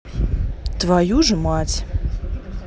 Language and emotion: Russian, neutral